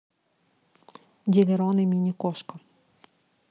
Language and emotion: Russian, neutral